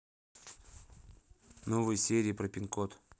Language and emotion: Russian, neutral